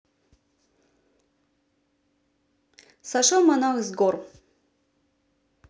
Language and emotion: Russian, neutral